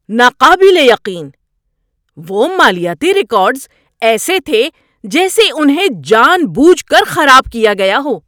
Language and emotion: Urdu, angry